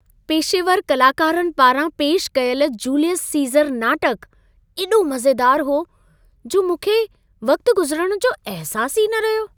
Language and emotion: Sindhi, happy